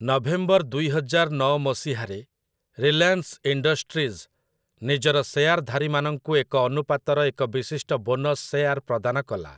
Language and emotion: Odia, neutral